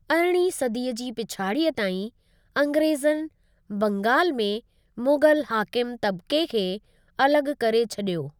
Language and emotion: Sindhi, neutral